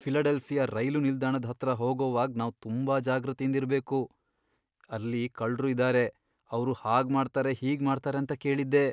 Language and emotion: Kannada, fearful